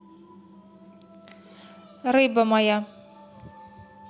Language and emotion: Russian, neutral